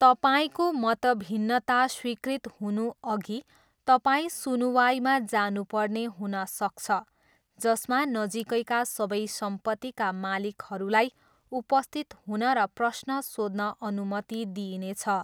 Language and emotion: Nepali, neutral